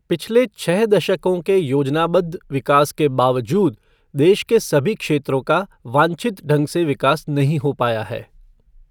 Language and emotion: Hindi, neutral